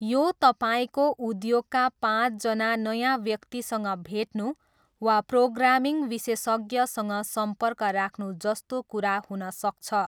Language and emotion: Nepali, neutral